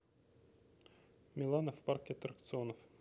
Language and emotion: Russian, neutral